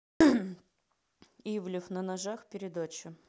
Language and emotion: Russian, neutral